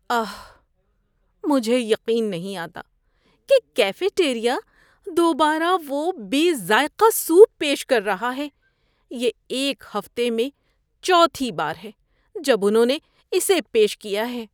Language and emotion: Urdu, disgusted